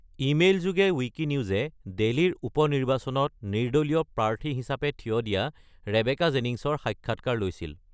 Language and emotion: Assamese, neutral